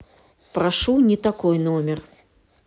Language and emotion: Russian, neutral